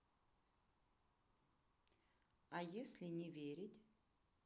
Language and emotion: Russian, neutral